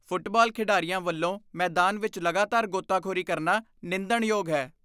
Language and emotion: Punjabi, disgusted